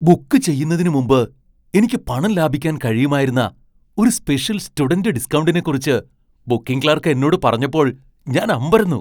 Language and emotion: Malayalam, surprised